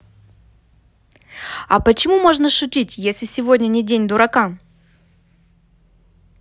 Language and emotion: Russian, neutral